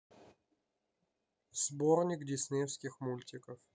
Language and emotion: Russian, neutral